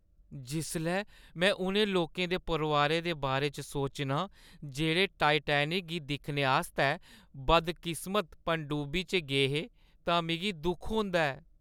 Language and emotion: Dogri, sad